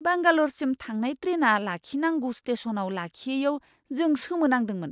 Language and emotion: Bodo, surprised